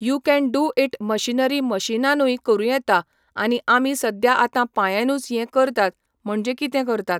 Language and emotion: Goan Konkani, neutral